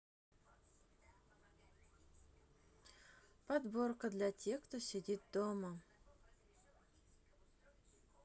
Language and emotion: Russian, sad